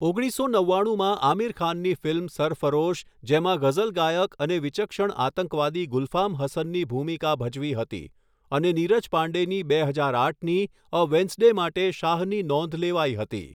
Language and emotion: Gujarati, neutral